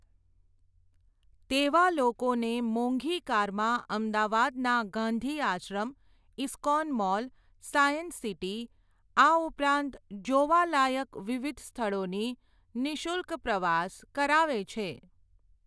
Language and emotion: Gujarati, neutral